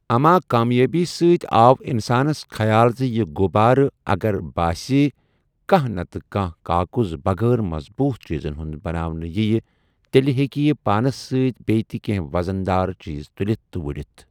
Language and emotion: Kashmiri, neutral